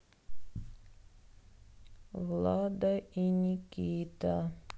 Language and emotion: Russian, sad